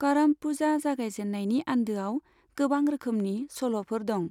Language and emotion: Bodo, neutral